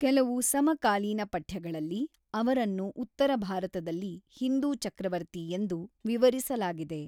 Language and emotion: Kannada, neutral